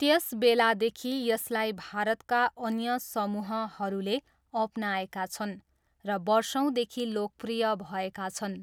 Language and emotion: Nepali, neutral